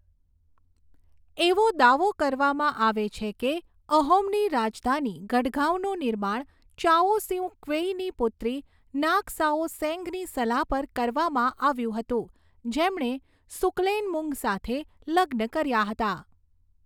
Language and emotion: Gujarati, neutral